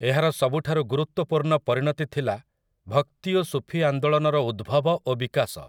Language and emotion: Odia, neutral